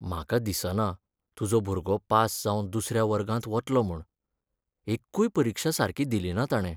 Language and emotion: Goan Konkani, sad